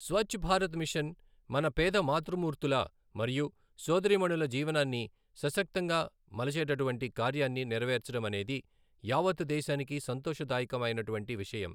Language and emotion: Telugu, neutral